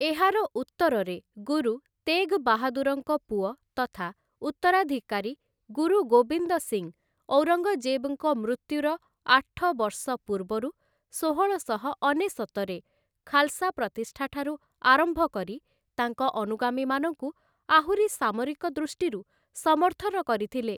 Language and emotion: Odia, neutral